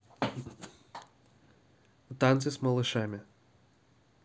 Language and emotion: Russian, neutral